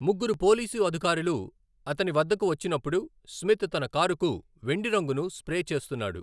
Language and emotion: Telugu, neutral